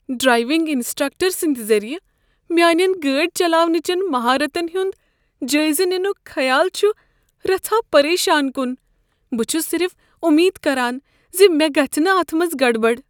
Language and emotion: Kashmiri, fearful